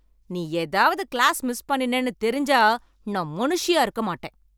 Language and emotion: Tamil, angry